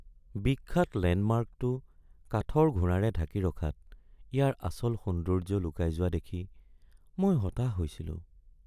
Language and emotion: Assamese, sad